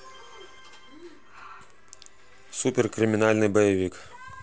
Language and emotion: Russian, neutral